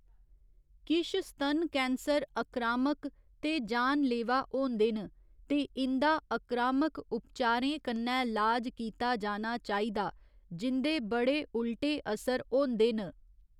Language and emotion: Dogri, neutral